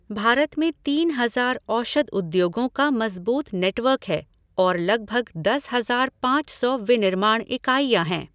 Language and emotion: Hindi, neutral